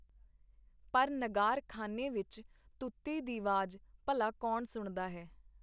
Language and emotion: Punjabi, neutral